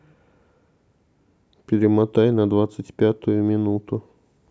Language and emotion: Russian, neutral